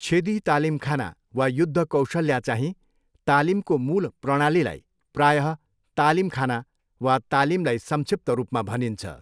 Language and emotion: Nepali, neutral